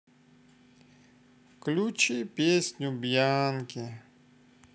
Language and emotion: Russian, sad